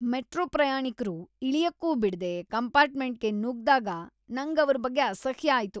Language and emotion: Kannada, disgusted